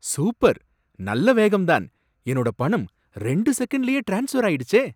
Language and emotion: Tamil, surprised